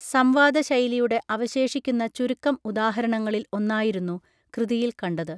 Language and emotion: Malayalam, neutral